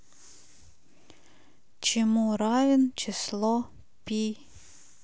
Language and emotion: Russian, neutral